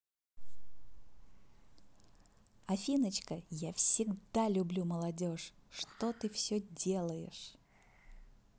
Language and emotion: Russian, positive